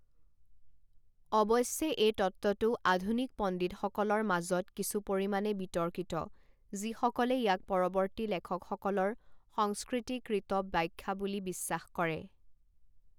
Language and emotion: Assamese, neutral